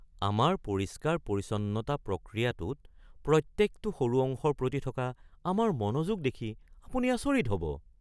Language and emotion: Assamese, surprised